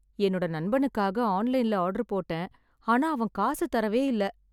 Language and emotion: Tamil, sad